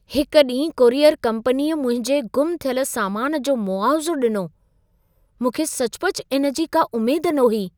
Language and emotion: Sindhi, surprised